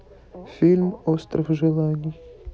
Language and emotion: Russian, neutral